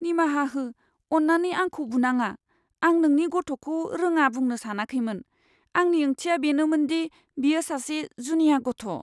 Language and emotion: Bodo, fearful